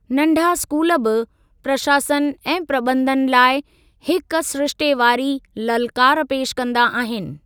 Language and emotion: Sindhi, neutral